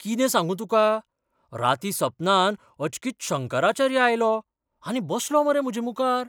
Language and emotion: Goan Konkani, surprised